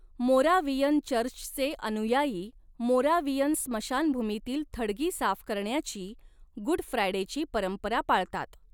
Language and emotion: Marathi, neutral